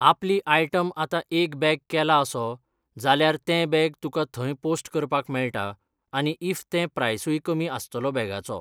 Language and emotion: Goan Konkani, neutral